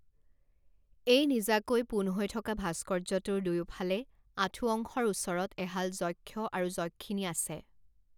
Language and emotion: Assamese, neutral